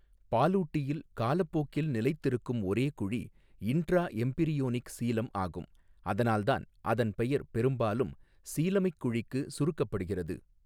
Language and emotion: Tamil, neutral